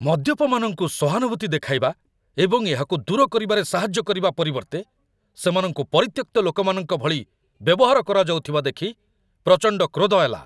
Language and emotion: Odia, angry